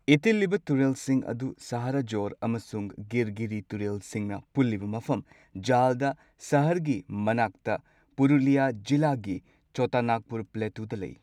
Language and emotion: Manipuri, neutral